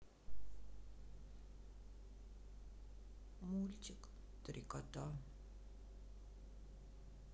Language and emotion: Russian, sad